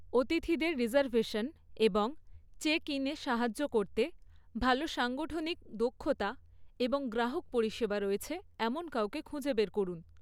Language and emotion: Bengali, neutral